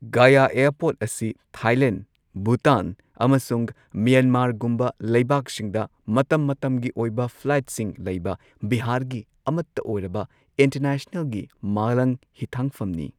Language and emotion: Manipuri, neutral